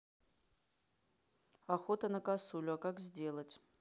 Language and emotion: Russian, neutral